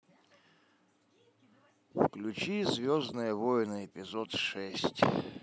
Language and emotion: Russian, sad